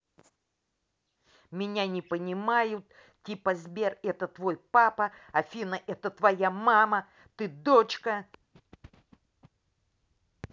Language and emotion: Russian, angry